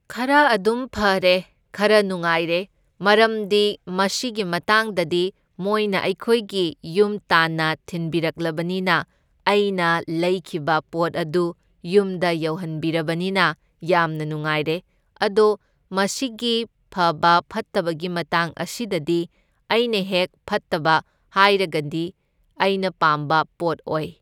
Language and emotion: Manipuri, neutral